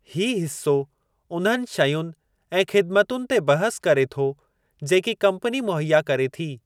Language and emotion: Sindhi, neutral